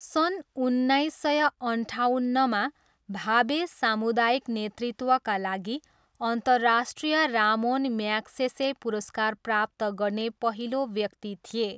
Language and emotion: Nepali, neutral